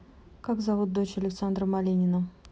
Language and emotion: Russian, neutral